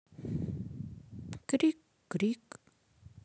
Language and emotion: Russian, sad